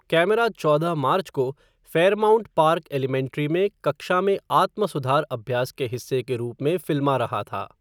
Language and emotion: Hindi, neutral